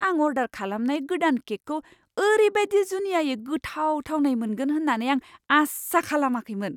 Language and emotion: Bodo, surprised